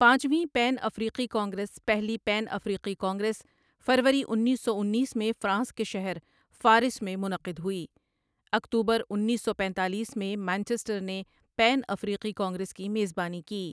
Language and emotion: Urdu, neutral